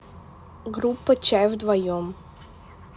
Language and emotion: Russian, neutral